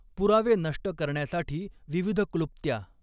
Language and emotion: Marathi, neutral